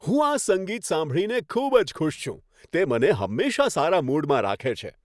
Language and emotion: Gujarati, happy